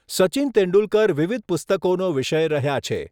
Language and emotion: Gujarati, neutral